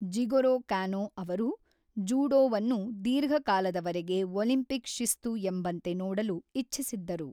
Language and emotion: Kannada, neutral